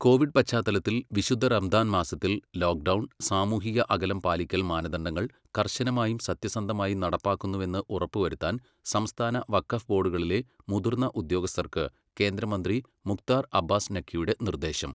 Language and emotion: Malayalam, neutral